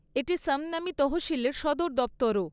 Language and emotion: Bengali, neutral